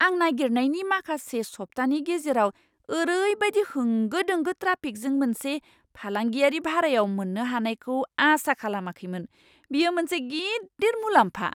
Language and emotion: Bodo, surprised